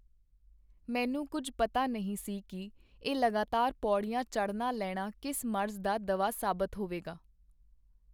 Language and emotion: Punjabi, neutral